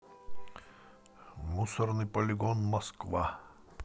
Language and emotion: Russian, neutral